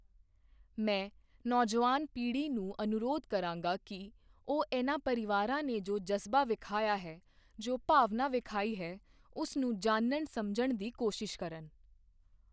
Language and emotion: Punjabi, neutral